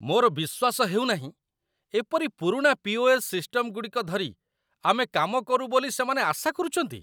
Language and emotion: Odia, disgusted